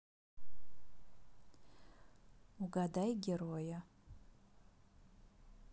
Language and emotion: Russian, neutral